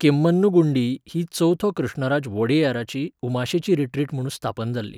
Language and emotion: Goan Konkani, neutral